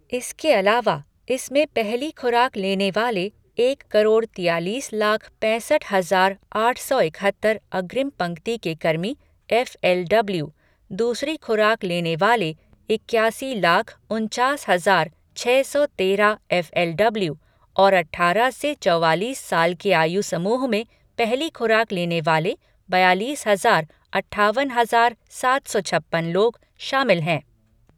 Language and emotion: Hindi, neutral